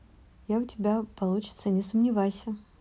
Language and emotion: Russian, neutral